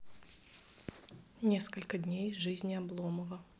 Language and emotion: Russian, neutral